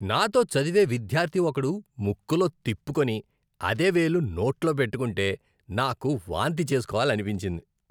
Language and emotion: Telugu, disgusted